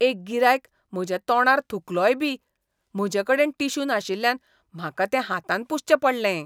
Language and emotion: Goan Konkani, disgusted